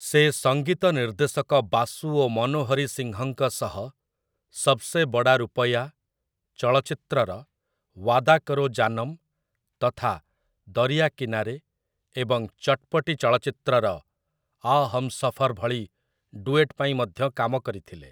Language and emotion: Odia, neutral